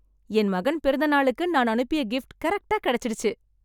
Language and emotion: Tamil, happy